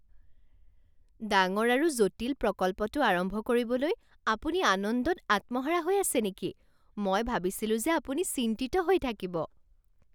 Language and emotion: Assamese, surprised